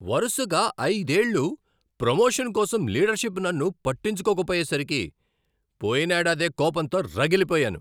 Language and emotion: Telugu, angry